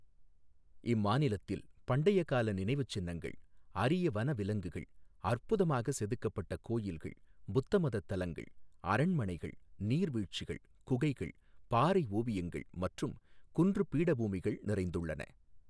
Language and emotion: Tamil, neutral